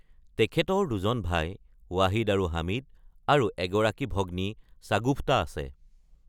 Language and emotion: Assamese, neutral